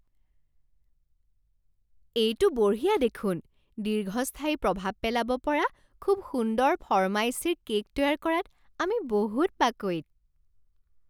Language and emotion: Assamese, surprised